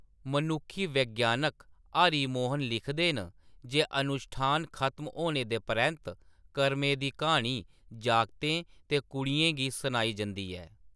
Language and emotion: Dogri, neutral